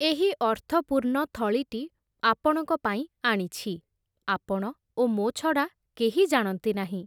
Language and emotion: Odia, neutral